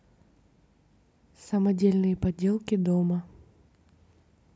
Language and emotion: Russian, neutral